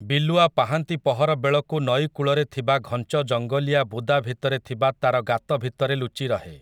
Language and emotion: Odia, neutral